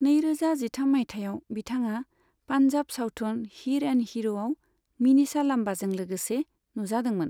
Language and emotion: Bodo, neutral